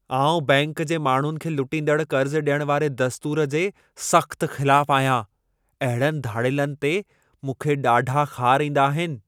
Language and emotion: Sindhi, angry